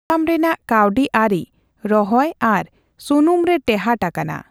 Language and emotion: Santali, neutral